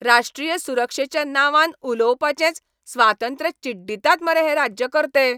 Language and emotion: Goan Konkani, angry